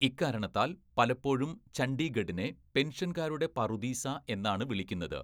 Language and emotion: Malayalam, neutral